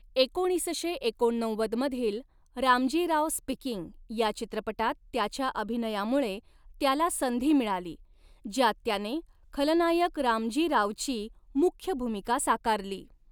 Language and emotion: Marathi, neutral